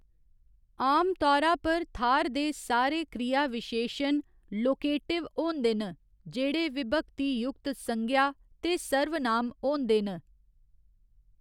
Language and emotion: Dogri, neutral